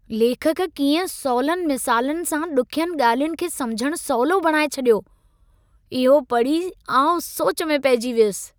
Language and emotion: Sindhi, surprised